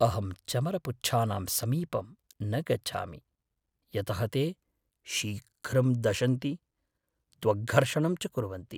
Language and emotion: Sanskrit, fearful